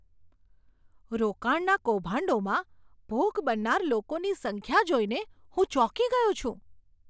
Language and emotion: Gujarati, surprised